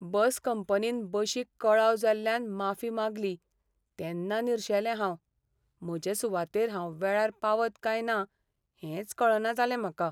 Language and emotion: Goan Konkani, sad